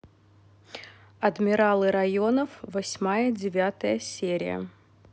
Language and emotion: Russian, neutral